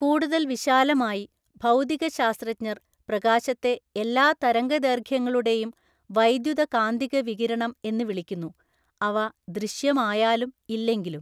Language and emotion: Malayalam, neutral